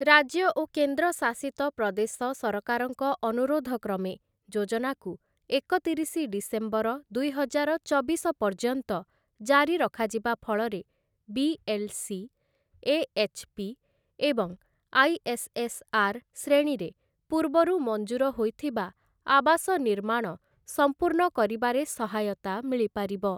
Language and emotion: Odia, neutral